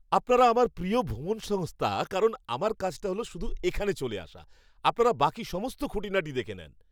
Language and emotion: Bengali, happy